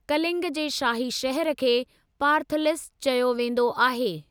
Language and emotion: Sindhi, neutral